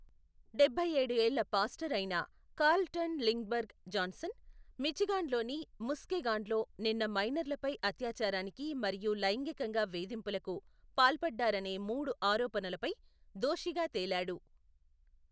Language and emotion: Telugu, neutral